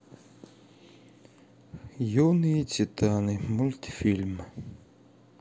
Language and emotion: Russian, sad